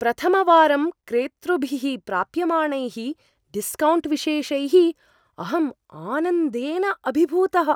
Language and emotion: Sanskrit, surprised